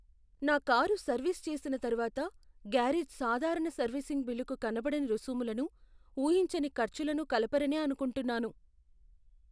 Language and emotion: Telugu, fearful